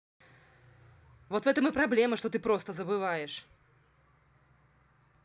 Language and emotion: Russian, angry